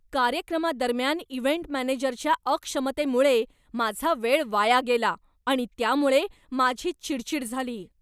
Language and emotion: Marathi, angry